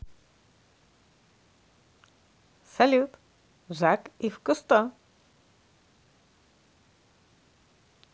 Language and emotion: Russian, positive